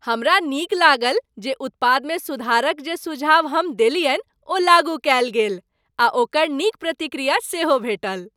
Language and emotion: Maithili, happy